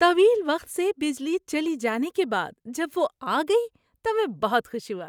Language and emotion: Urdu, happy